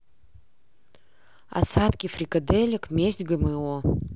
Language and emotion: Russian, neutral